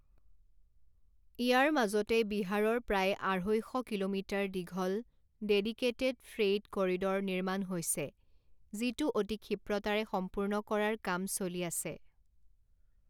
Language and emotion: Assamese, neutral